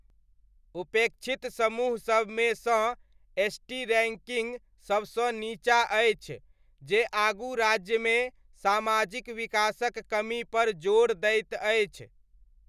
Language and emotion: Maithili, neutral